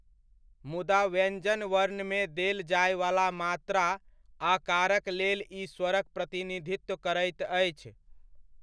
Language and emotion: Maithili, neutral